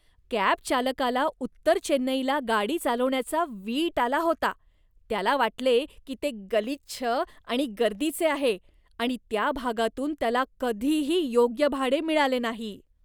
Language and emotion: Marathi, disgusted